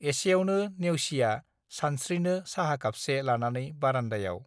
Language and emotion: Bodo, neutral